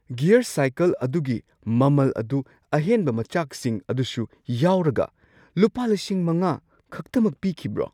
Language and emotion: Manipuri, surprised